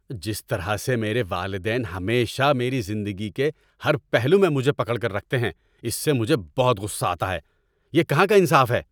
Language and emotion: Urdu, angry